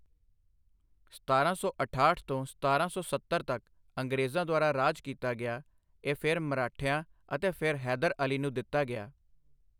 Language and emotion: Punjabi, neutral